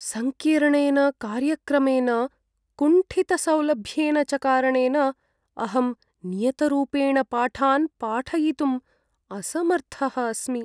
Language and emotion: Sanskrit, sad